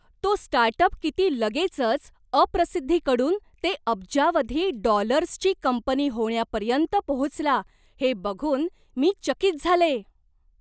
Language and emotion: Marathi, surprised